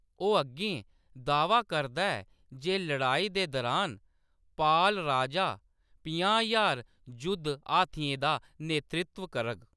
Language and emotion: Dogri, neutral